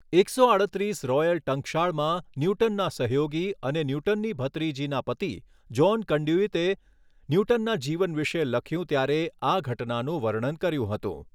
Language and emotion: Gujarati, neutral